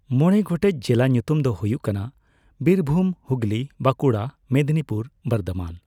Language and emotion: Santali, neutral